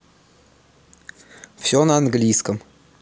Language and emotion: Russian, neutral